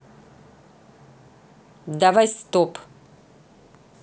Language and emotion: Russian, neutral